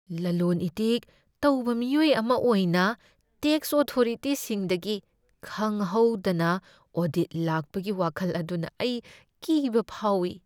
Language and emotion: Manipuri, fearful